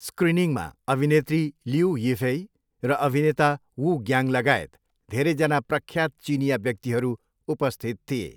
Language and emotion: Nepali, neutral